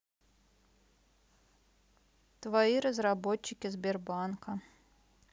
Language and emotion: Russian, neutral